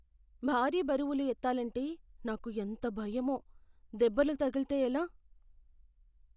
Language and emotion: Telugu, fearful